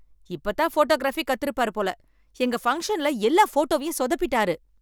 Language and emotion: Tamil, angry